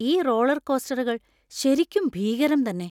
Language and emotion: Malayalam, fearful